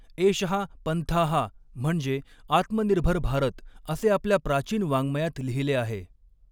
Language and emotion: Marathi, neutral